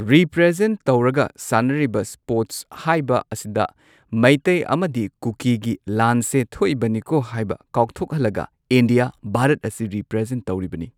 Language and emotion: Manipuri, neutral